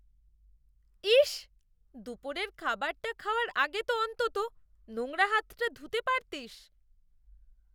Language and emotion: Bengali, disgusted